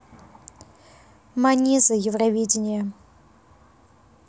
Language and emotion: Russian, neutral